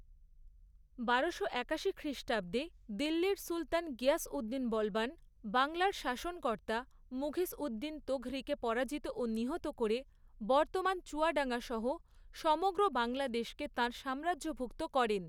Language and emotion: Bengali, neutral